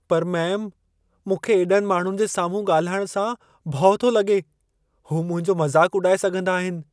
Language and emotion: Sindhi, fearful